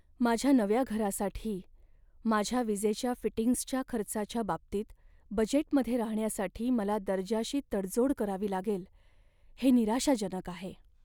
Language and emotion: Marathi, sad